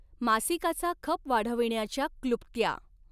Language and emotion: Marathi, neutral